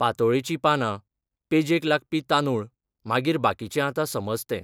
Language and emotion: Goan Konkani, neutral